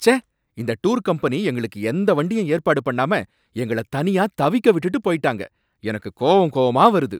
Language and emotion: Tamil, angry